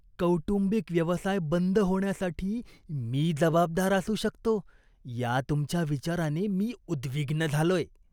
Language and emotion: Marathi, disgusted